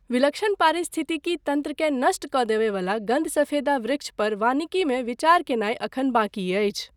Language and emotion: Maithili, neutral